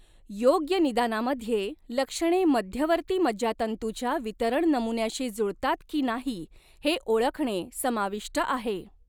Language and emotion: Marathi, neutral